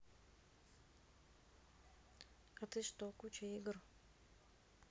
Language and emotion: Russian, neutral